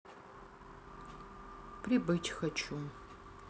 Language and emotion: Russian, sad